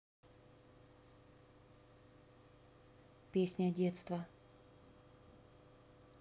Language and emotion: Russian, neutral